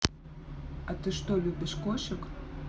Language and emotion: Russian, neutral